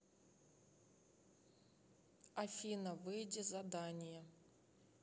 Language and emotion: Russian, neutral